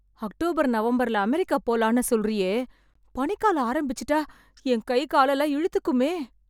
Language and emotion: Tamil, fearful